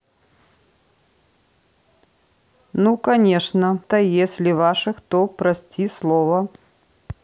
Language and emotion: Russian, neutral